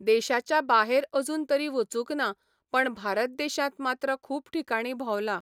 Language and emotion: Goan Konkani, neutral